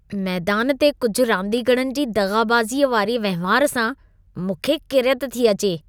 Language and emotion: Sindhi, disgusted